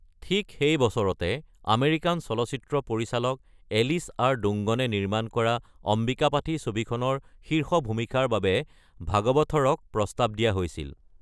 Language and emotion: Assamese, neutral